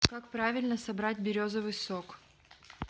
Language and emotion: Russian, neutral